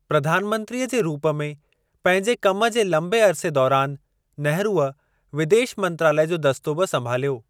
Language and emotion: Sindhi, neutral